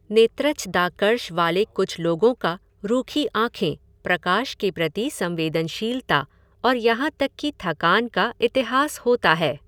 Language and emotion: Hindi, neutral